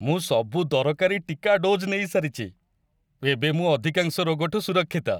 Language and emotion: Odia, happy